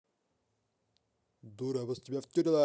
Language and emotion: Russian, angry